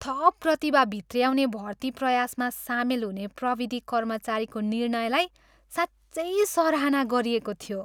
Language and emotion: Nepali, happy